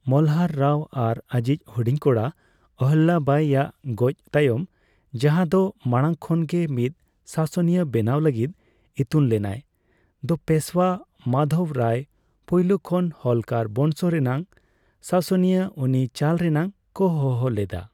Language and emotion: Santali, neutral